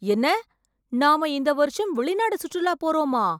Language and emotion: Tamil, surprised